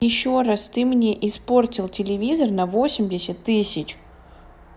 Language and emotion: Russian, neutral